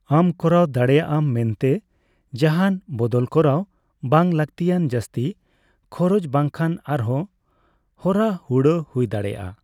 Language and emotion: Santali, neutral